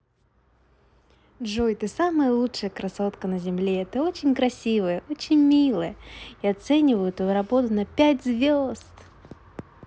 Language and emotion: Russian, positive